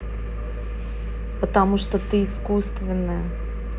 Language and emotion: Russian, neutral